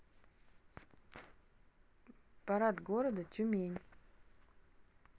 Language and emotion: Russian, neutral